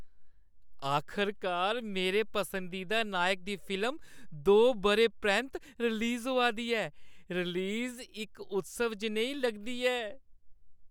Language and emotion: Dogri, happy